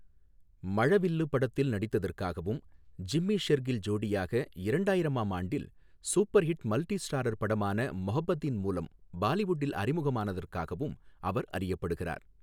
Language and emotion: Tamil, neutral